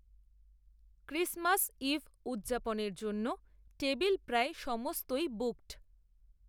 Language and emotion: Bengali, neutral